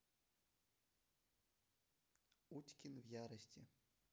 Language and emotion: Russian, neutral